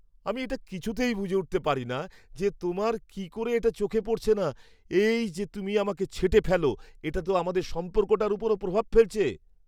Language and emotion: Bengali, surprised